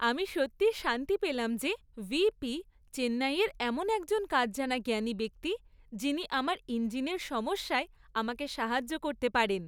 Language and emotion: Bengali, happy